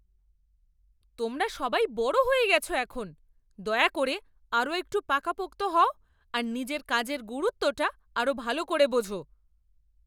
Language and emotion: Bengali, angry